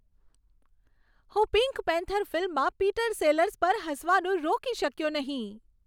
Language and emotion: Gujarati, happy